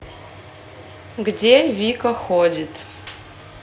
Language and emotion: Russian, neutral